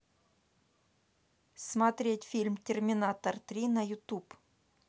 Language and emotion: Russian, neutral